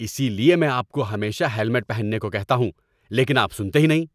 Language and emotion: Urdu, angry